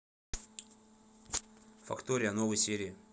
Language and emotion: Russian, neutral